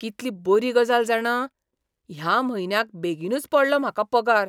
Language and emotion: Goan Konkani, surprised